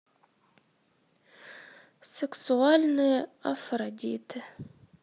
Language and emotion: Russian, sad